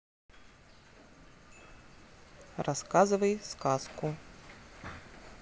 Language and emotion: Russian, neutral